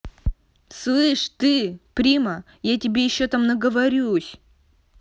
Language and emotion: Russian, angry